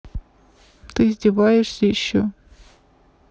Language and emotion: Russian, sad